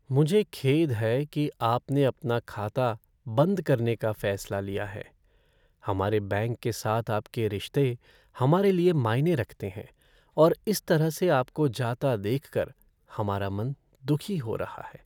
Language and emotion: Hindi, sad